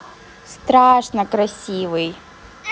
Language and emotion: Russian, positive